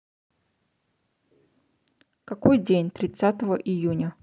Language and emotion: Russian, neutral